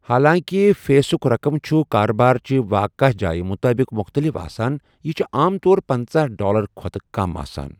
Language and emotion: Kashmiri, neutral